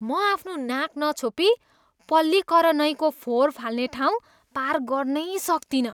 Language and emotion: Nepali, disgusted